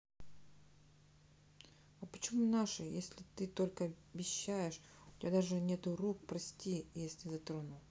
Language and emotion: Russian, neutral